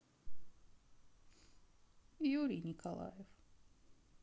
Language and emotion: Russian, sad